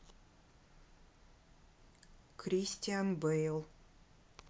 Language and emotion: Russian, neutral